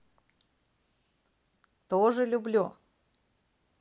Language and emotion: Russian, positive